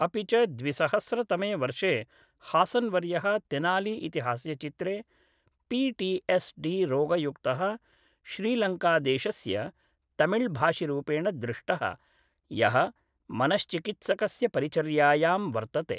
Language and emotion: Sanskrit, neutral